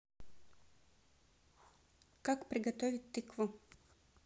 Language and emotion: Russian, neutral